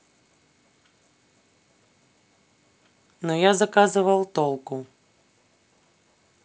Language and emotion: Russian, neutral